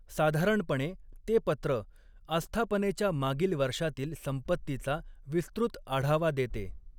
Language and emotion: Marathi, neutral